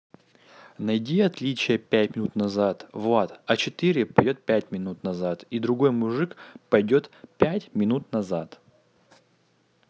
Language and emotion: Russian, neutral